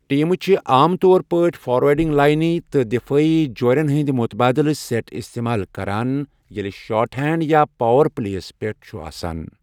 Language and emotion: Kashmiri, neutral